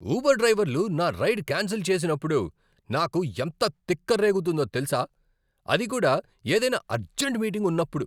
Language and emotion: Telugu, angry